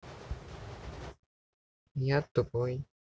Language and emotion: Russian, neutral